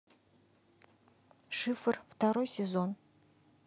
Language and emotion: Russian, neutral